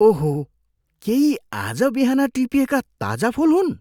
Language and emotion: Nepali, surprised